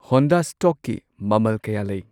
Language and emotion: Manipuri, neutral